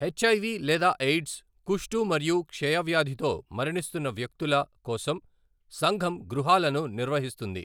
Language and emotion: Telugu, neutral